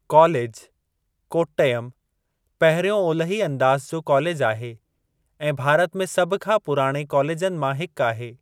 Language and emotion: Sindhi, neutral